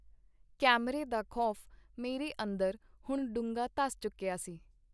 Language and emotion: Punjabi, neutral